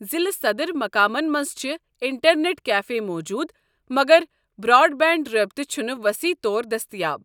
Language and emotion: Kashmiri, neutral